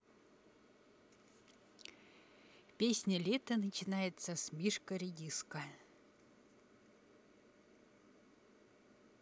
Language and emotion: Russian, neutral